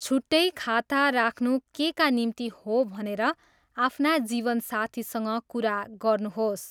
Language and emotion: Nepali, neutral